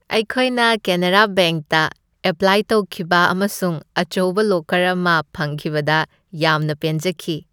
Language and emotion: Manipuri, happy